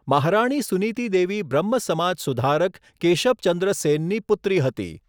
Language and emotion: Gujarati, neutral